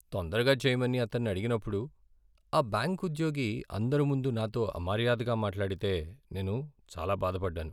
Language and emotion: Telugu, sad